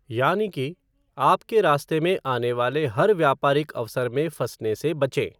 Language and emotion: Hindi, neutral